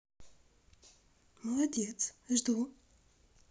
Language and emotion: Russian, neutral